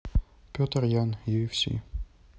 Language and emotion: Russian, neutral